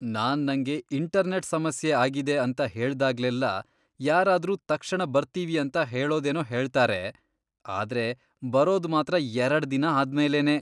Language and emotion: Kannada, disgusted